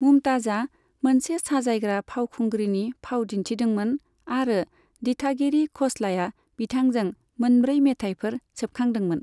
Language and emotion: Bodo, neutral